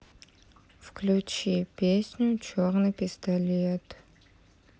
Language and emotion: Russian, sad